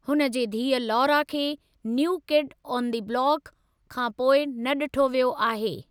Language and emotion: Sindhi, neutral